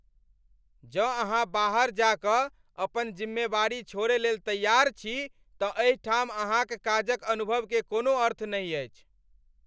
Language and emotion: Maithili, angry